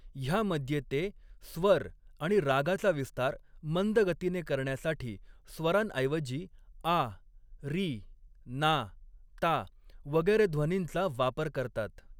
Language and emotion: Marathi, neutral